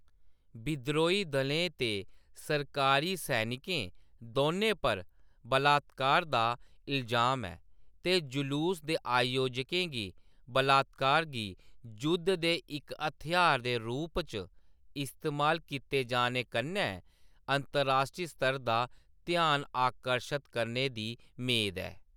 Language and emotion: Dogri, neutral